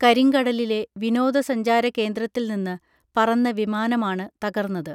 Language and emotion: Malayalam, neutral